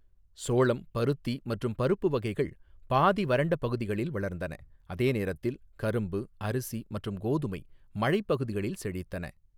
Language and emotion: Tamil, neutral